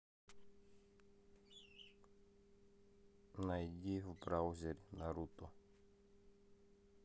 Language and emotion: Russian, neutral